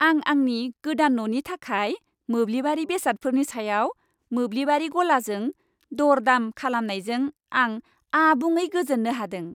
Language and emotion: Bodo, happy